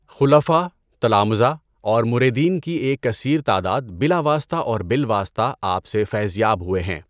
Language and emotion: Urdu, neutral